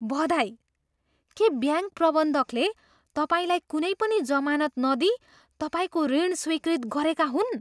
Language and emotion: Nepali, surprised